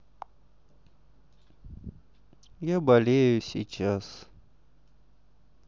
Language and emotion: Russian, sad